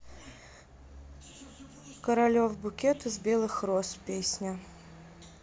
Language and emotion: Russian, neutral